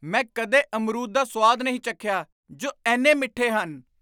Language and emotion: Punjabi, surprised